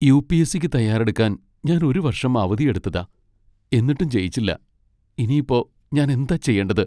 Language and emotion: Malayalam, sad